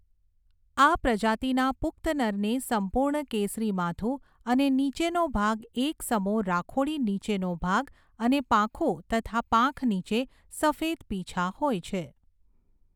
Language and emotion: Gujarati, neutral